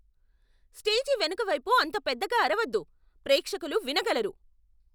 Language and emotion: Telugu, angry